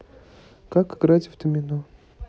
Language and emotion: Russian, neutral